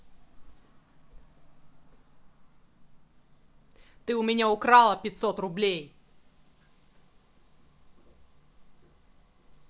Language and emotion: Russian, angry